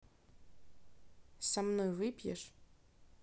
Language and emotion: Russian, neutral